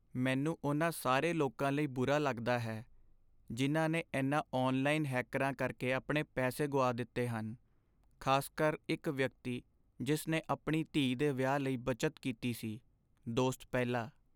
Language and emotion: Punjabi, sad